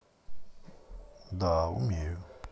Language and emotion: Russian, neutral